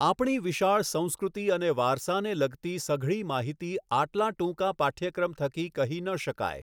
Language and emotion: Gujarati, neutral